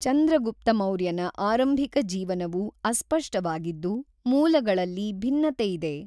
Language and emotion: Kannada, neutral